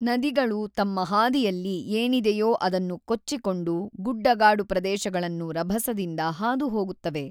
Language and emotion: Kannada, neutral